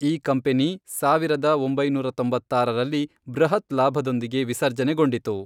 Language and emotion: Kannada, neutral